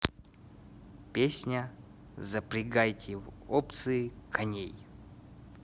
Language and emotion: Russian, neutral